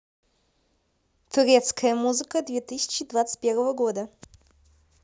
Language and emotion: Russian, neutral